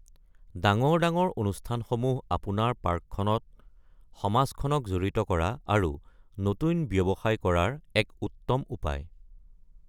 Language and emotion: Assamese, neutral